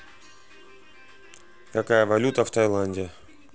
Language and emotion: Russian, neutral